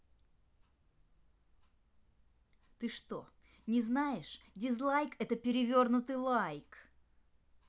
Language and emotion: Russian, angry